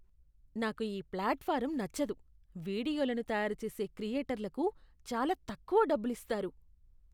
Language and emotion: Telugu, disgusted